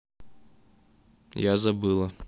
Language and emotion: Russian, neutral